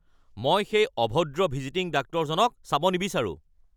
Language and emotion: Assamese, angry